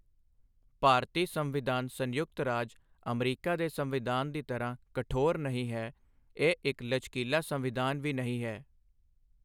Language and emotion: Punjabi, neutral